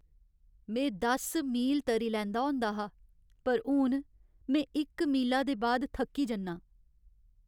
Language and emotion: Dogri, sad